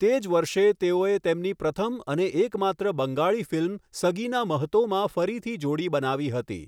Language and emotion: Gujarati, neutral